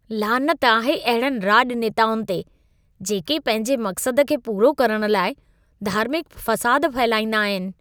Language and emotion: Sindhi, disgusted